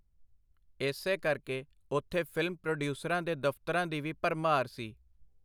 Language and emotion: Punjabi, neutral